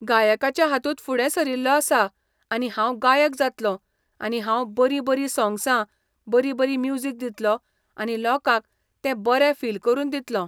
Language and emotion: Goan Konkani, neutral